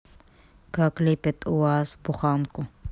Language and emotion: Russian, neutral